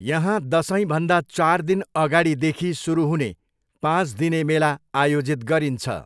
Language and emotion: Nepali, neutral